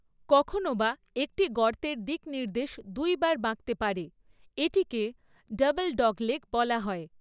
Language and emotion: Bengali, neutral